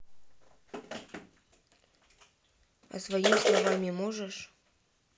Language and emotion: Russian, neutral